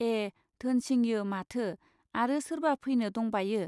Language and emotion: Bodo, neutral